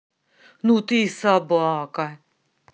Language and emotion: Russian, angry